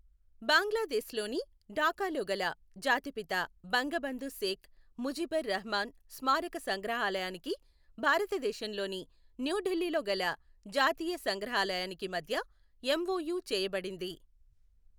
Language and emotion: Telugu, neutral